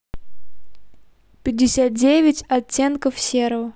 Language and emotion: Russian, neutral